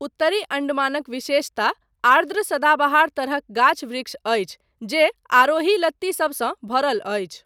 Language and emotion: Maithili, neutral